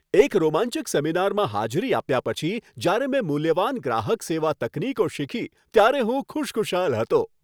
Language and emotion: Gujarati, happy